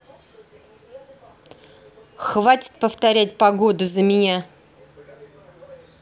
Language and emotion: Russian, angry